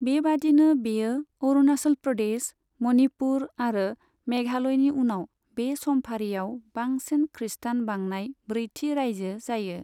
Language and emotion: Bodo, neutral